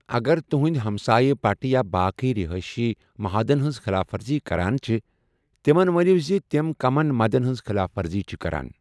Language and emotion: Kashmiri, neutral